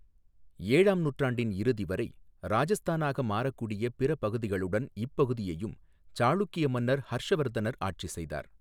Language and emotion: Tamil, neutral